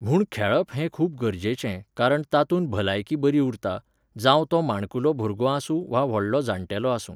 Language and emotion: Goan Konkani, neutral